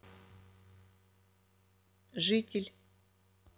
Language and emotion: Russian, neutral